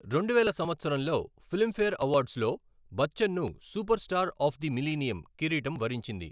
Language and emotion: Telugu, neutral